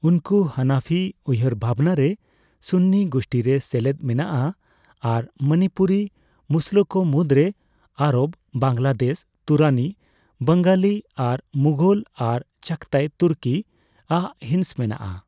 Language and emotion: Santali, neutral